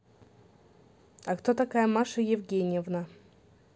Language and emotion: Russian, neutral